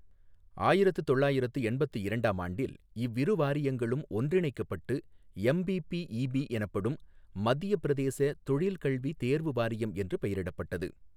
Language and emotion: Tamil, neutral